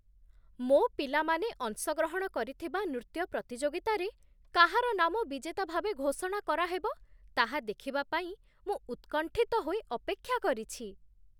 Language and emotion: Odia, surprised